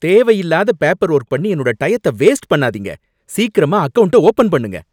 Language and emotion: Tamil, angry